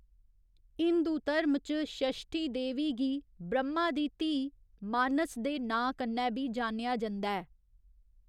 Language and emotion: Dogri, neutral